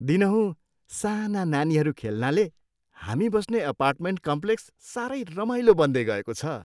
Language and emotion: Nepali, happy